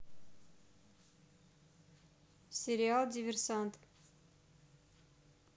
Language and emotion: Russian, neutral